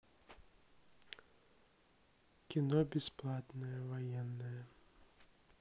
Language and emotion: Russian, neutral